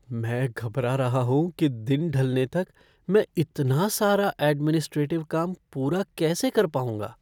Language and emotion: Hindi, fearful